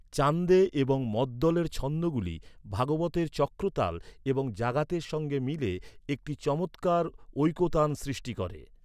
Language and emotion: Bengali, neutral